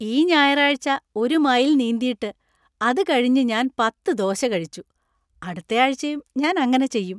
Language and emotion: Malayalam, happy